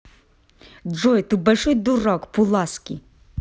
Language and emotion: Russian, angry